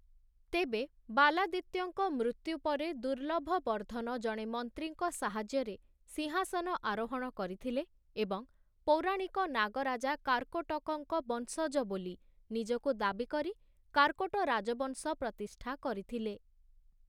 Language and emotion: Odia, neutral